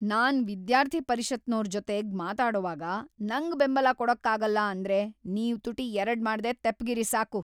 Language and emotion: Kannada, angry